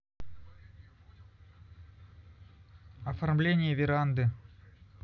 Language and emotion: Russian, neutral